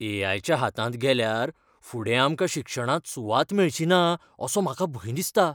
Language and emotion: Goan Konkani, fearful